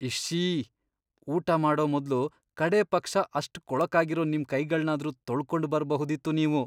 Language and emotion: Kannada, disgusted